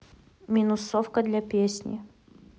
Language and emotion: Russian, neutral